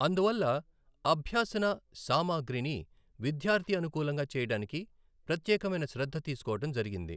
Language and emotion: Telugu, neutral